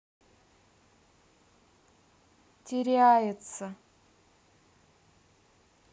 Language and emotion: Russian, sad